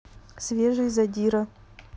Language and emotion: Russian, neutral